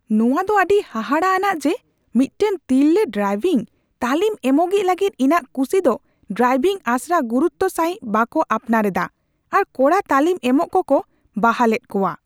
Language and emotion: Santali, angry